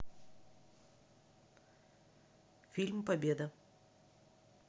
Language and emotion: Russian, neutral